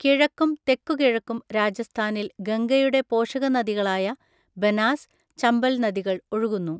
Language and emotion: Malayalam, neutral